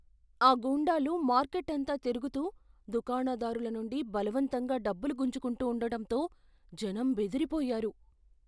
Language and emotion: Telugu, fearful